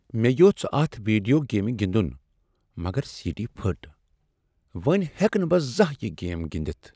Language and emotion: Kashmiri, sad